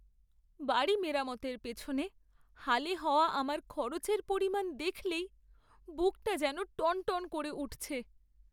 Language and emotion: Bengali, sad